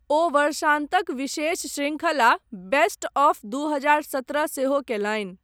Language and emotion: Maithili, neutral